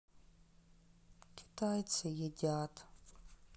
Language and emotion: Russian, sad